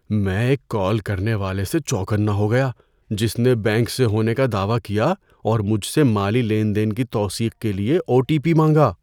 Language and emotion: Urdu, fearful